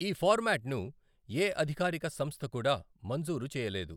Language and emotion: Telugu, neutral